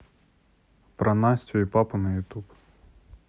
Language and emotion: Russian, neutral